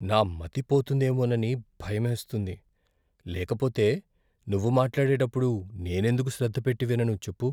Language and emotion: Telugu, fearful